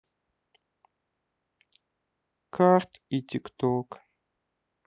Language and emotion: Russian, sad